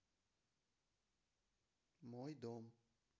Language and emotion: Russian, neutral